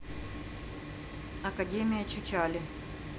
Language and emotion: Russian, neutral